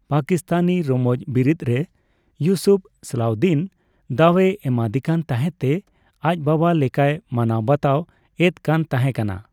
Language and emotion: Santali, neutral